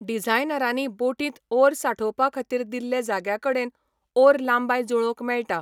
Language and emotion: Goan Konkani, neutral